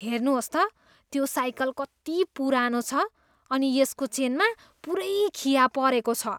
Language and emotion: Nepali, disgusted